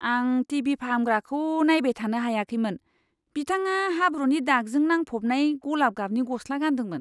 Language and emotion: Bodo, disgusted